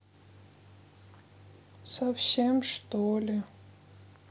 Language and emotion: Russian, sad